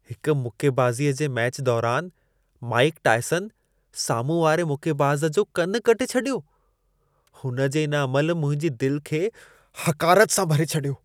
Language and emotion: Sindhi, disgusted